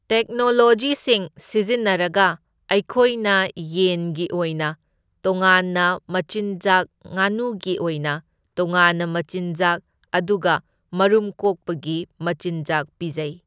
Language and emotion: Manipuri, neutral